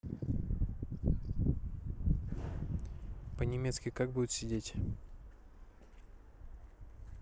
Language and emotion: Russian, neutral